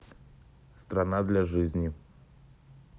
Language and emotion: Russian, neutral